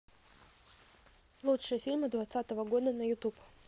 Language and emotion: Russian, neutral